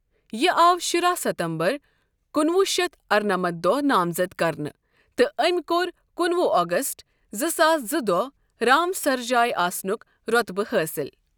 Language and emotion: Kashmiri, neutral